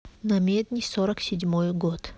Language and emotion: Russian, neutral